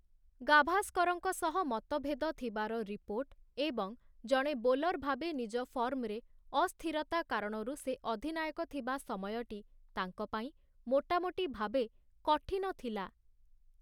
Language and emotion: Odia, neutral